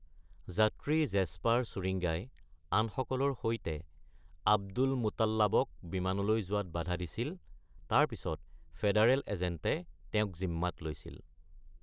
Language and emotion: Assamese, neutral